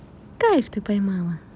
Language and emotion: Russian, positive